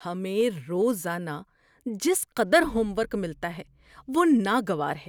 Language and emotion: Urdu, disgusted